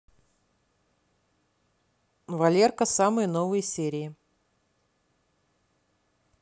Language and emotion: Russian, neutral